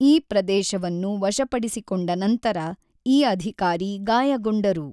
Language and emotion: Kannada, neutral